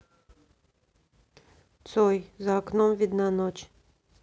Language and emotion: Russian, neutral